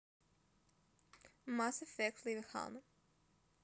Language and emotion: Russian, neutral